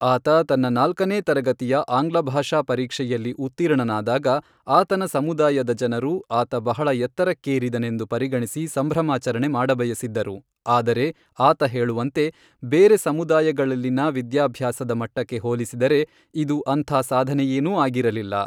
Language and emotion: Kannada, neutral